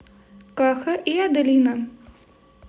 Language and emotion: Russian, neutral